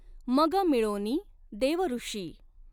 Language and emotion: Marathi, neutral